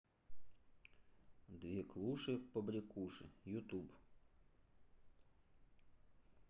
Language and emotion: Russian, neutral